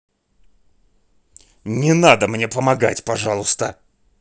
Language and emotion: Russian, angry